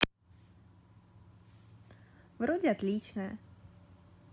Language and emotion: Russian, positive